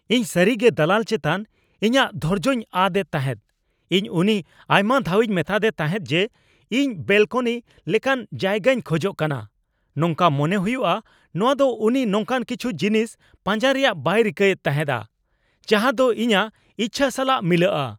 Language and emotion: Santali, angry